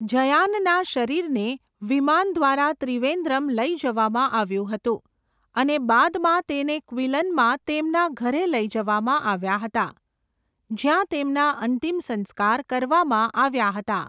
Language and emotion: Gujarati, neutral